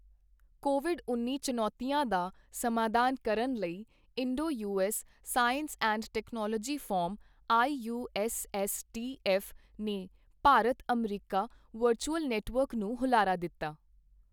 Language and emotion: Punjabi, neutral